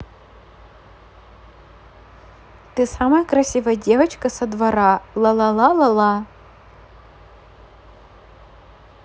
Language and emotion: Russian, positive